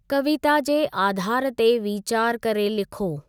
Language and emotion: Sindhi, neutral